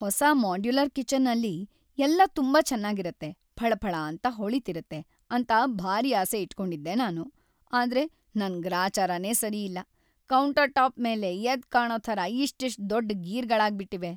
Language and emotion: Kannada, sad